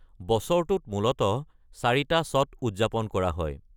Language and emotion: Assamese, neutral